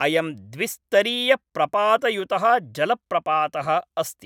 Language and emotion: Sanskrit, neutral